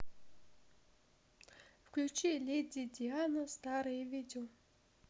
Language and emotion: Russian, neutral